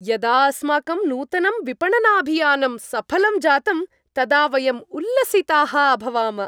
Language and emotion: Sanskrit, happy